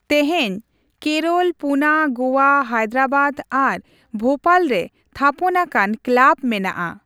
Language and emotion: Santali, neutral